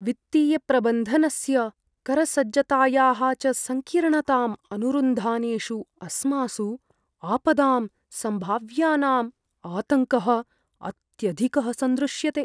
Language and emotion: Sanskrit, fearful